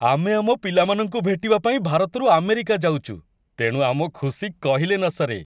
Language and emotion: Odia, happy